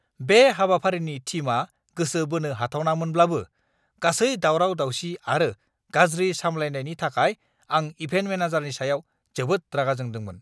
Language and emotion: Bodo, angry